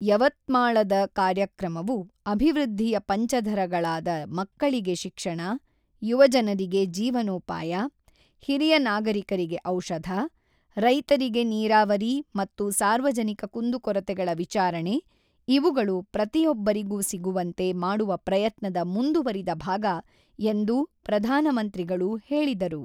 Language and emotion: Kannada, neutral